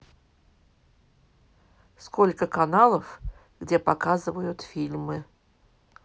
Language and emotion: Russian, neutral